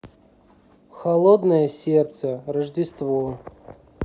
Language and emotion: Russian, neutral